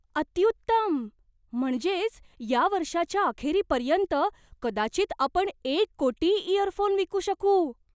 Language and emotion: Marathi, surprised